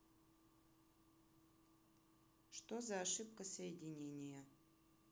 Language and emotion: Russian, neutral